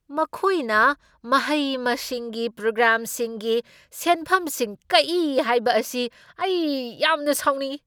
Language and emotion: Manipuri, angry